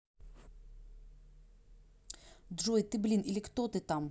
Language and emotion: Russian, angry